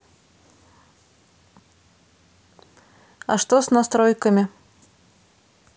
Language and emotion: Russian, neutral